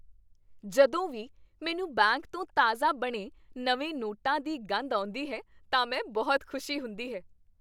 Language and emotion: Punjabi, happy